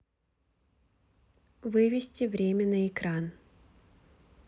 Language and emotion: Russian, neutral